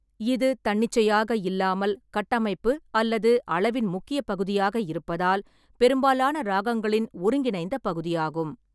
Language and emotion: Tamil, neutral